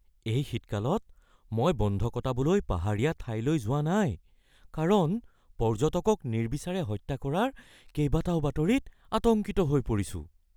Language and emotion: Assamese, fearful